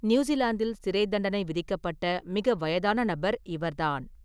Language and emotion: Tamil, neutral